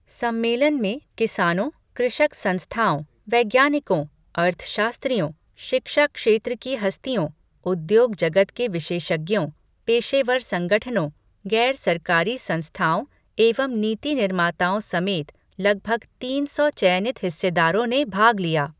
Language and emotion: Hindi, neutral